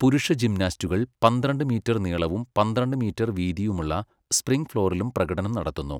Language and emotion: Malayalam, neutral